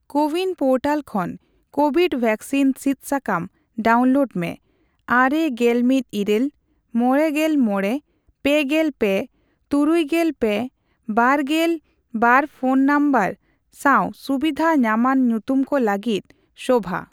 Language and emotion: Santali, neutral